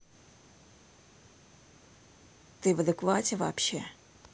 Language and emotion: Russian, angry